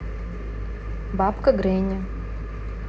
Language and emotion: Russian, neutral